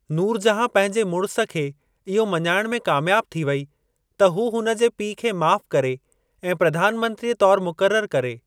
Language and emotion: Sindhi, neutral